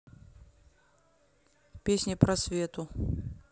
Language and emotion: Russian, neutral